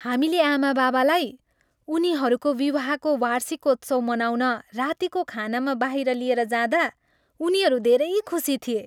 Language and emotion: Nepali, happy